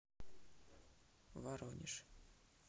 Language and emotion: Russian, neutral